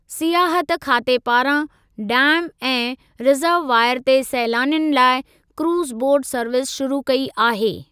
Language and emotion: Sindhi, neutral